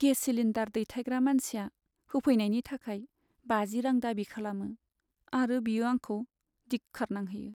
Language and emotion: Bodo, sad